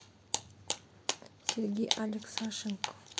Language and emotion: Russian, neutral